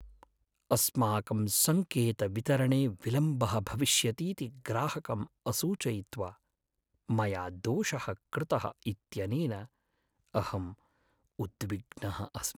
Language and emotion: Sanskrit, sad